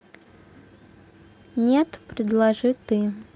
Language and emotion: Russian, neutral